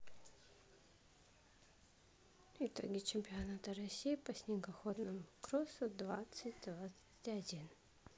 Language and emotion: Russian, neutral